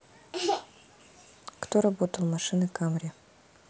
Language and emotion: Russian, neutral